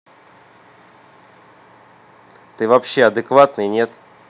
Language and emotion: Russian, angry